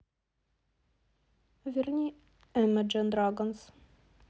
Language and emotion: Russian, neutral